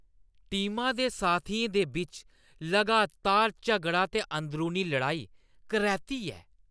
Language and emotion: Dogri, disgusted